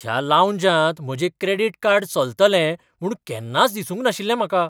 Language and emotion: Goan Konkani, surprised